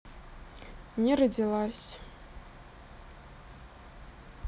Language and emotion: Russian, sad